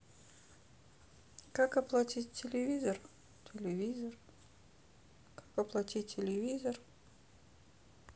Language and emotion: Russian, sad